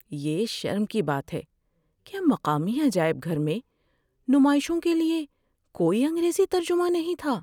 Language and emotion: Urdu, sad